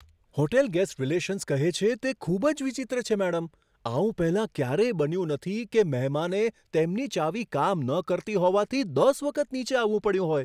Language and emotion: Gujarati, surprised